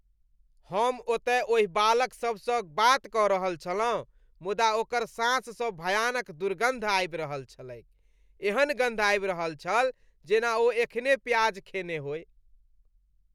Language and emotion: Maithili, disgusted